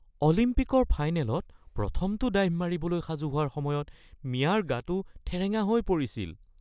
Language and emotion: Assamese, fearful